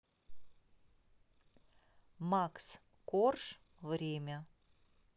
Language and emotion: Russian, neutral